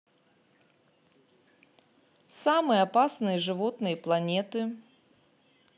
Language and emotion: Russian, neutral